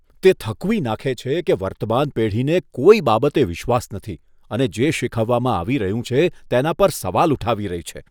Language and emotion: Gujarati, disgusted